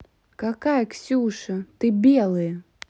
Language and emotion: Russian, angry